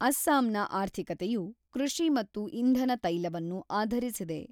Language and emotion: Kannada, neutral